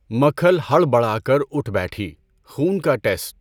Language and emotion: Urdu, neutral